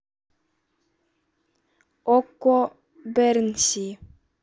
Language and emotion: Russian, neutral